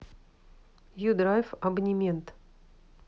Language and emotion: Russian, neutral